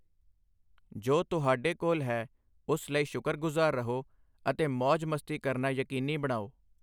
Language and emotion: Punjabi, neutral